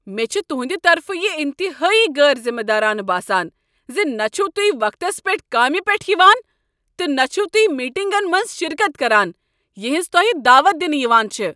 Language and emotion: Kashmiri, angry